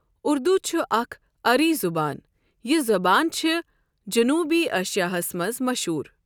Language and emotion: Kashmiri, neutral